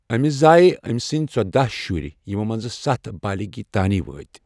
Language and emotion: Kashmiri, neutral